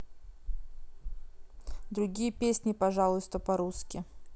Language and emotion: Russian, neutral